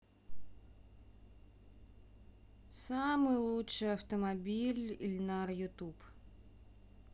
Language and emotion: Russian, sad